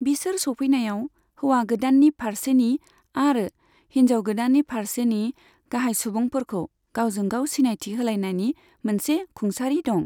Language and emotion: Bodo, neutral